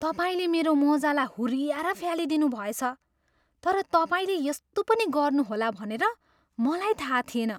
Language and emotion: Nepali, surprised